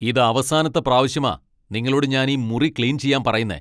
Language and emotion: Malayalam, angry